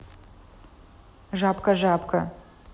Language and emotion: Russian, neutral